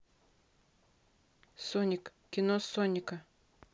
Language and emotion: Russian, neutral